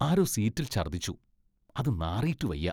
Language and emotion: Malayalam, disgusted